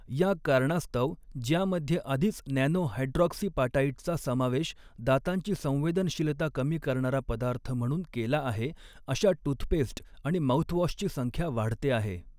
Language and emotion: Marathi, neutral